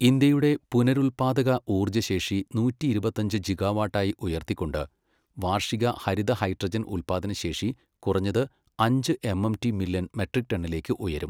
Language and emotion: Malayalam, neutral